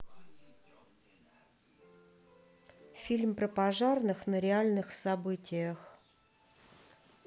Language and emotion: Russian, neutral